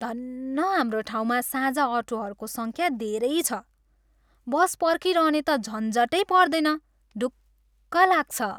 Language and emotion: Nepali, happy